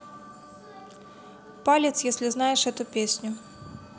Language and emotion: Russian, neutral